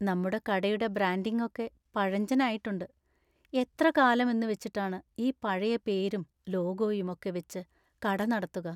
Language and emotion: Malayalam, sad